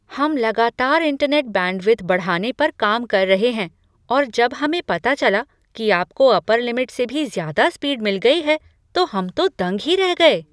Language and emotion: Hindi, surprised